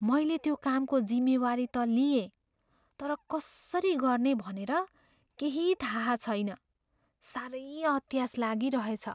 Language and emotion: Nepali, fearful